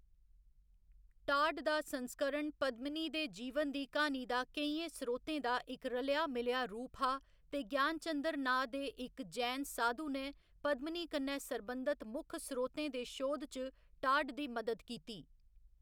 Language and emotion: Dogri, neutral